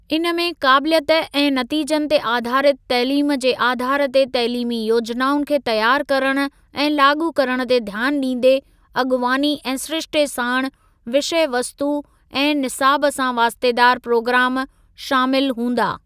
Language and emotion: Sindhi, neutral